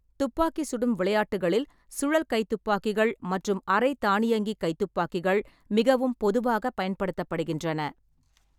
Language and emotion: Tamil, neutral